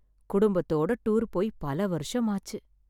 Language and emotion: Tamil, sad